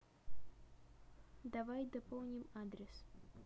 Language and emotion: Russian, neutral